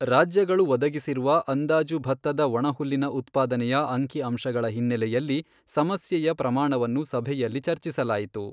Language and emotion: Kannada, neutral